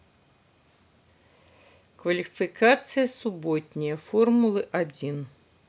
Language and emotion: Russian, neutral